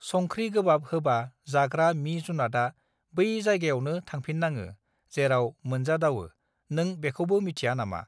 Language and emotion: Bodo, neutral